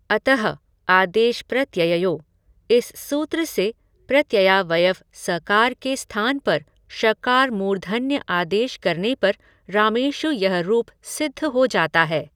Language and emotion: Hindi, neutral